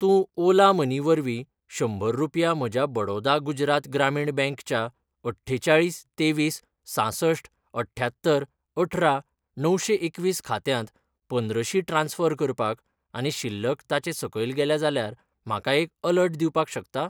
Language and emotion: Goan Konkani, neutral